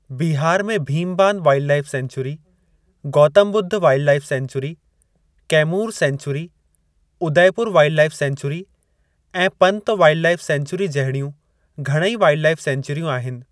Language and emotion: Sindhi, neutral